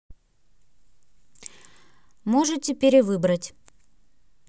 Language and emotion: Russian, neutral